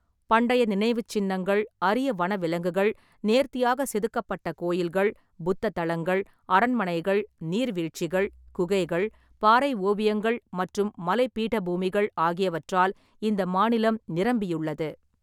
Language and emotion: Tamil, neutral